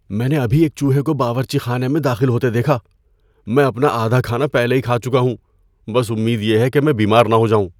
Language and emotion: Urdu, fearful